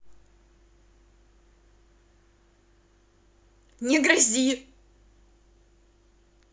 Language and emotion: Russian, angry